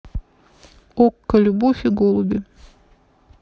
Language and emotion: Russian, neutral